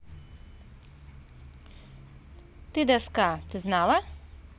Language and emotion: Russian, neutral